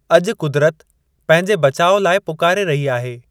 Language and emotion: Sindhi, neutral